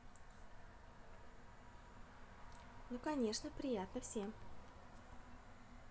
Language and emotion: Russian, positive